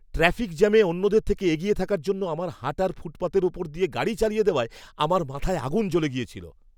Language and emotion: Bengali, angry